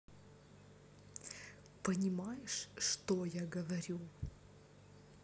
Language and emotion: Russian, neutral